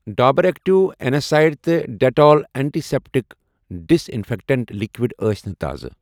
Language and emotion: Kashmiri, neutral